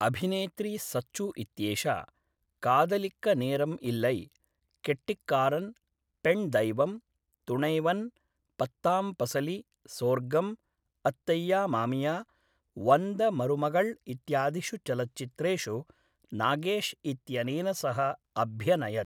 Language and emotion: Sanskrit, neutral